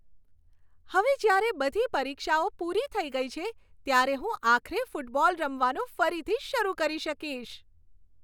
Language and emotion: Gujarati, happy